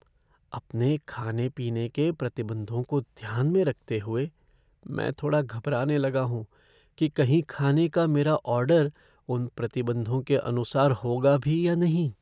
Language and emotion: Hindi, fearful